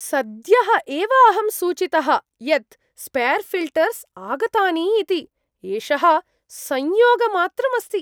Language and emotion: Sanskrit, surprised